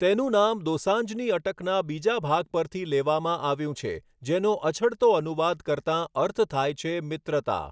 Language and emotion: Gujarati, neutral